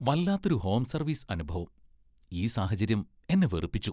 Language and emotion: Malayalam, disgusted